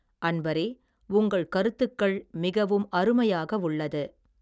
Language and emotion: Tamil, neutral